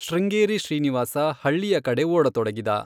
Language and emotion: Kannada, neutral